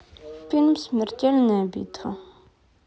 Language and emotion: Russian, sad